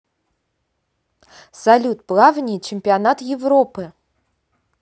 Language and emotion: Russian, positive